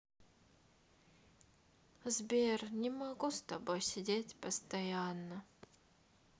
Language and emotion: Russian, sad